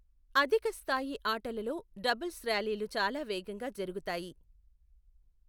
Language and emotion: Telugu, neutral